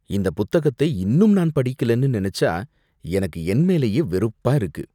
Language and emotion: Tamil, disgusted